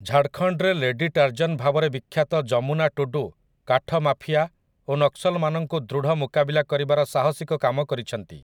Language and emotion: Odia, neutral